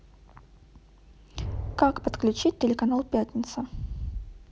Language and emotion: Russian, neutral